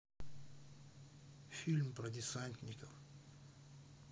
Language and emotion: Russian, sad